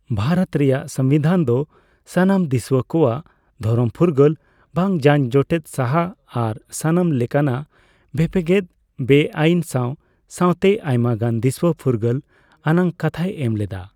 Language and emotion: Santali, neutral